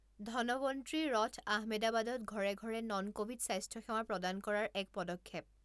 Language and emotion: Assamese, neutral